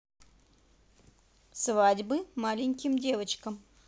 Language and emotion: Russian, positive